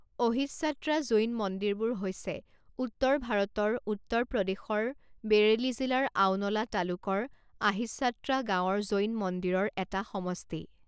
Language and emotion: Assamese, neutral